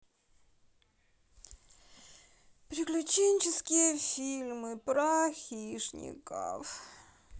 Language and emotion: Russian, sad